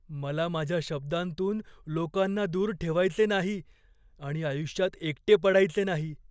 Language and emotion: Marathi, fearful